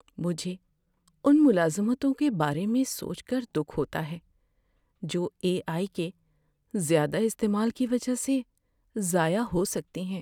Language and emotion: Urdu, sad